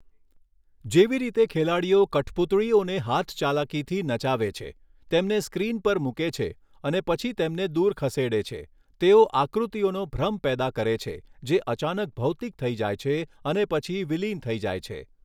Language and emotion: Gujarati, neutral